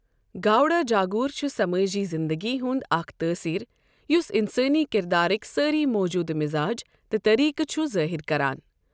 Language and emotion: Kashmiri, neutral